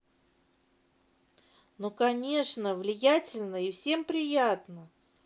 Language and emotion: Russian, positive